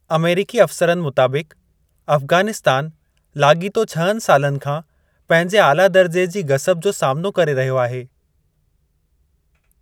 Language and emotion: Sindhi, neutral